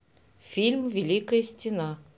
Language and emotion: Russian, neutral